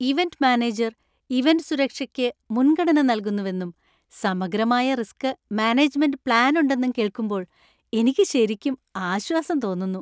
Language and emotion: Malayalam, happy